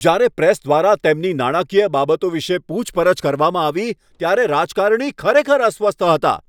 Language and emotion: Gujarati, angry